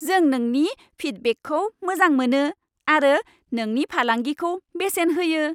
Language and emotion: Bodo, happy